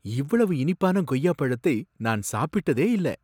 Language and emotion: Tamil, surprised